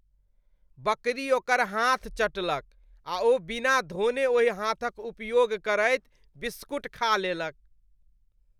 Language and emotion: Maithili, disgusted